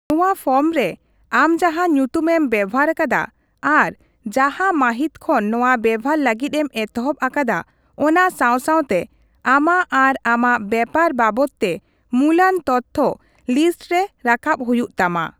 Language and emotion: Santali, neutral